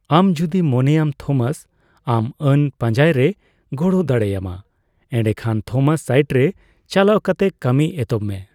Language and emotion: Santali, neutral